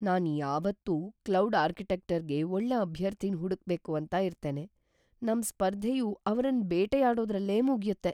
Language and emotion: Kannada, fearful